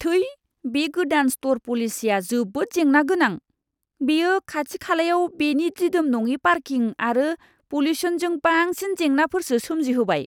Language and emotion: Bodo, disgusted